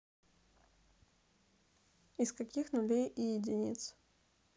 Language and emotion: Russian, neutral